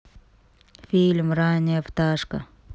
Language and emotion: Russian, neutral